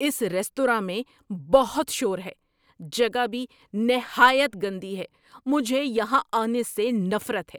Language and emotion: Urdu, angry